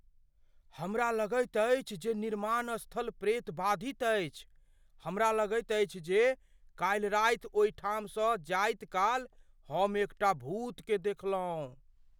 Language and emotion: Maithili, fearful